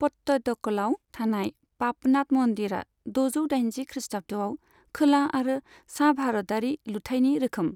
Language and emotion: Bodo, neutral